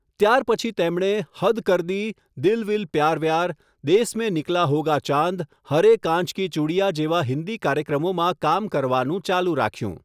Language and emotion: Gujarati, neutral